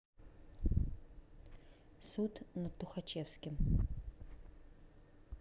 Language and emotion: Russian, neutral